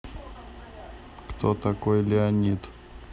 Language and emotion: Russian, neutral